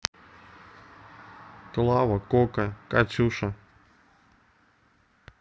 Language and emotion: Russian, neutral